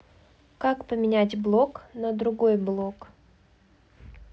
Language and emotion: Russian, neutral